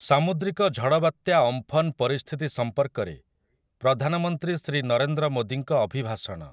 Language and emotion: Odia, neutral